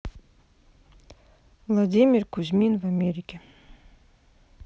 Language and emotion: Russian, neutral